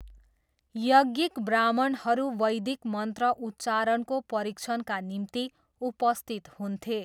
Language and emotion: Nepali, neutral